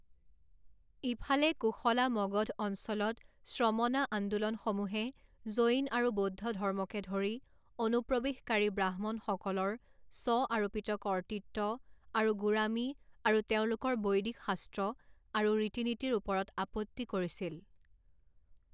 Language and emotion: Assamese, neutral